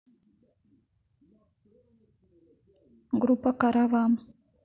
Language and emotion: Russian, neutral